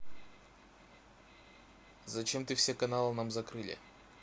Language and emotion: Russian, neutral